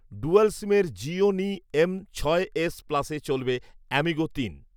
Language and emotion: Bengali, neutral